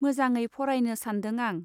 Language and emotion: Bodo, neutral